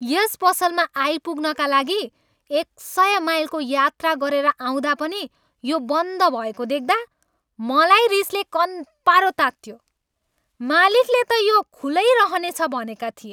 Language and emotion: Nepali, angry